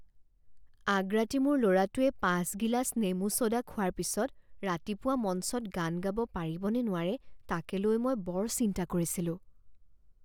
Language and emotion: Assamese, fearful